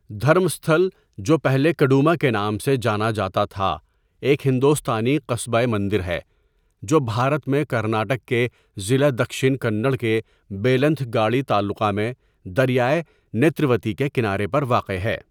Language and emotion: Urdu, neutral